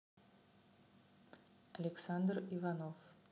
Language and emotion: Russian, neutral